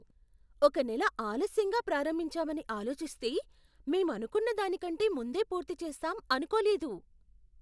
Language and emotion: Telugu, surprised